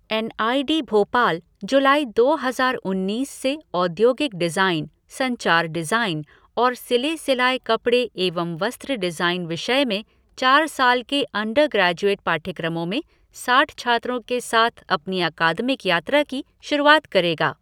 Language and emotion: Hindi, neutral